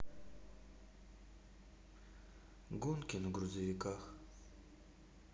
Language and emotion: Russian, sad